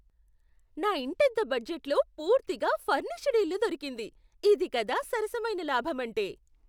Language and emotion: Telugu, surprised